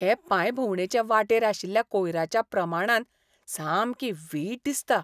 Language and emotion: Goan Konkani, disgusted